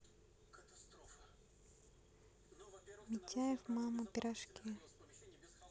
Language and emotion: Russian, neutral